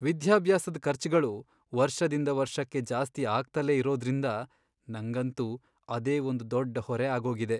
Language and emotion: Kannada, sad